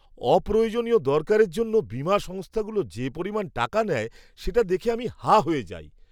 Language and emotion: Bengali, surprised